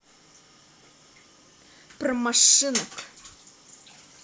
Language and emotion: Russian, angry